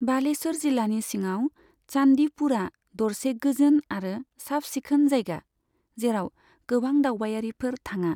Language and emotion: Bodo, neutral